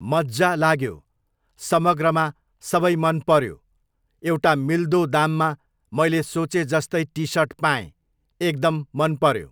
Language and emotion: Nepali, neutral